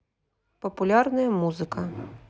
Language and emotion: Russian, neutral